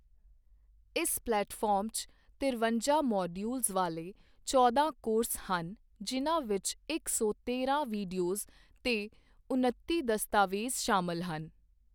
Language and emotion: Punjabi, neutral